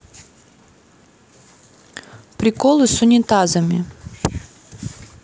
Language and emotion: Russian, neutral